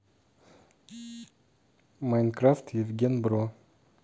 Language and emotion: Russian, neutral